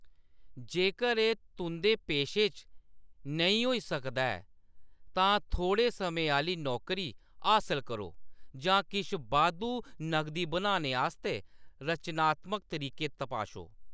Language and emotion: Dogri, neutral